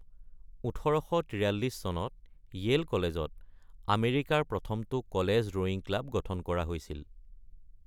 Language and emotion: Assamese, neutral